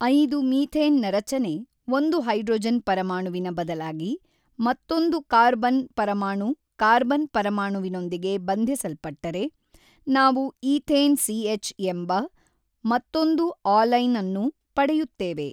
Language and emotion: Kannada, neutral